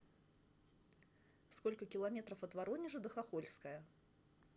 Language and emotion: Russian, neutral